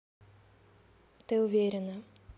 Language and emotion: Russian, neutral